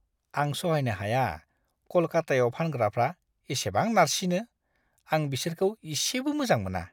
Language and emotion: Bodo, disgusted